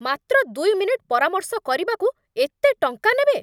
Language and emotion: Odia, angry